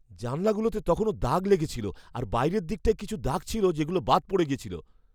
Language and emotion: Bengali, fearful